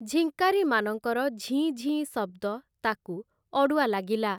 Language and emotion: Odia, neutral